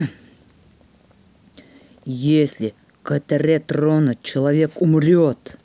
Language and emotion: Russian, angry